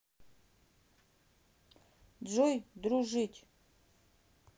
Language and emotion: Russian, neutral